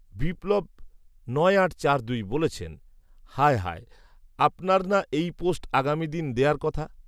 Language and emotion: Bengali, neutral